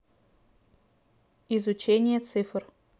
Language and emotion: Russian, neutral